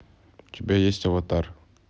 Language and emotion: Russian, neutral